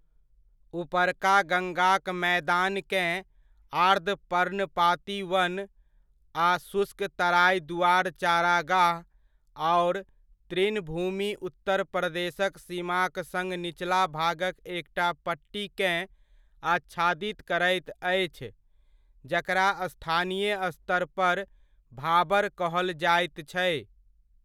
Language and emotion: Maithili, neutral